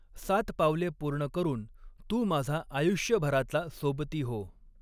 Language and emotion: Marathi, neutral